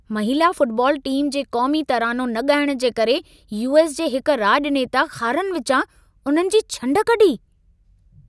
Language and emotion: Sindhi, angry